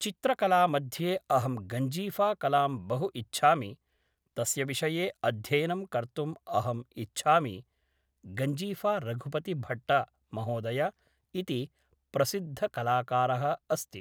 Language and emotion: Sanskrit, neutral